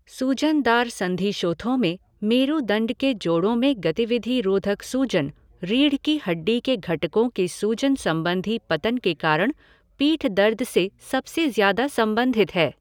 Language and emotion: Hindi, neutral